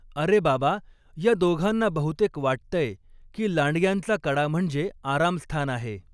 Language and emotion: Marathi, neutral